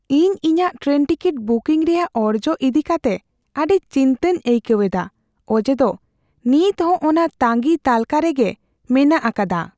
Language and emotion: Santali, fearful